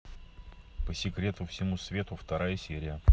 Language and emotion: Russian, neutral